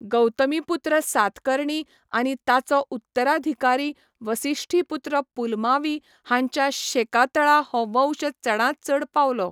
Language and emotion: Goan Konkani, neutral